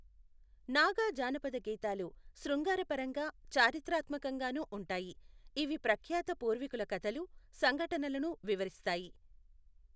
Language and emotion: Telugu, neutral